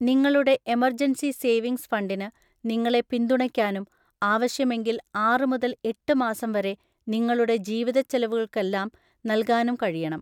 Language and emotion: Malayalam, neutral